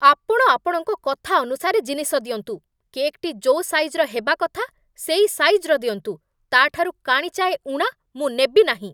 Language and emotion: Odia, angry